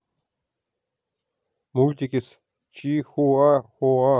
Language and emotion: Russian, neutral